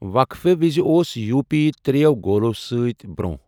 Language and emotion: Kashmiri, neutral